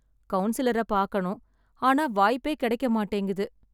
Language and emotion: Tamil, sad